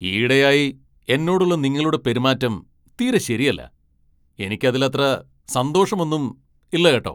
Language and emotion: Malayalam, angry